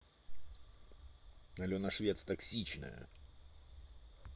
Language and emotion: Russian, angry